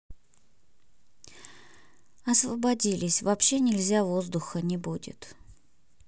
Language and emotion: Russian, sad